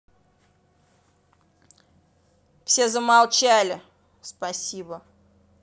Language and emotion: Russian, angry